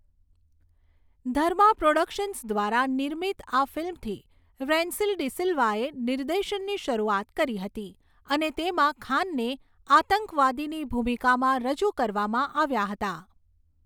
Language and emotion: Gujarati, neutral